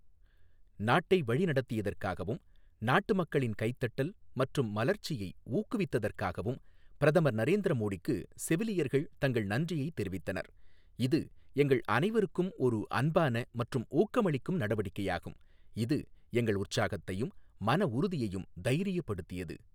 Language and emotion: Tamil, neutral